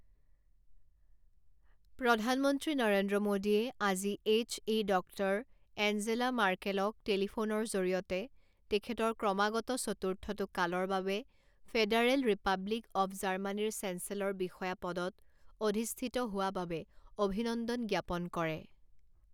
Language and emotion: Assamese, neutral